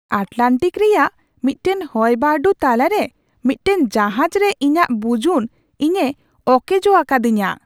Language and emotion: Santali, surprised